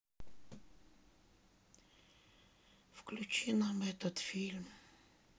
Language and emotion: Russian, sad